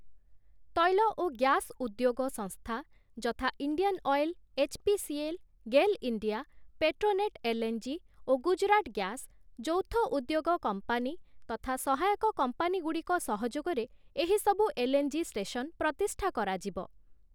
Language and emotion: Odia, neutral